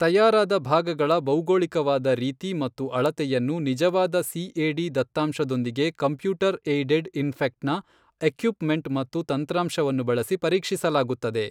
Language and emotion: Kannada, neutral